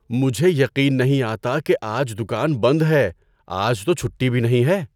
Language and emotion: Urdu, surprised